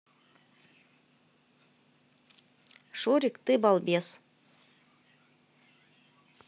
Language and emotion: Russian, positive